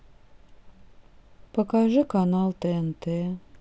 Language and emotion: Russian, sad